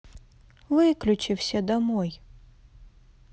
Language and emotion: Russian, sad